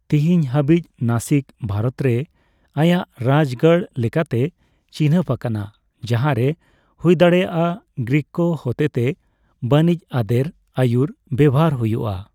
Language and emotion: Santali, neutral